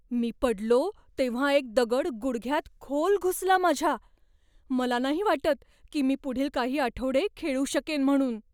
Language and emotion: Marathi, fearful